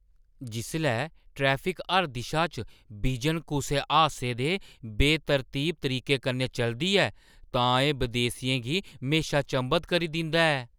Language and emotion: Dogri, surprised